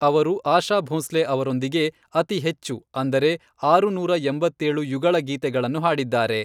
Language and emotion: Kannada, neutral